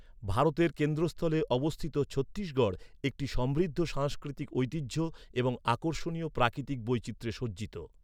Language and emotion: Bengali, neutral